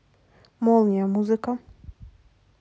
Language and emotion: Russian, neutral